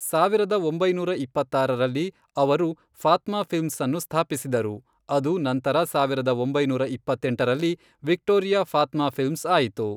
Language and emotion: Kannada, neutral